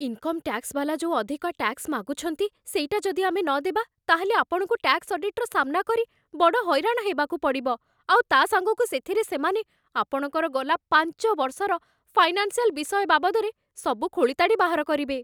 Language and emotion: Odia, fearful